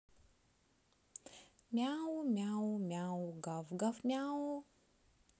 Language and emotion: Russian, neutral